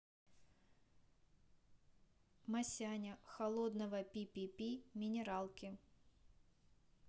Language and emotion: Russian, neutral